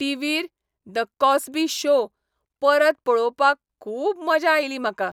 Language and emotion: Goan Konkani, happy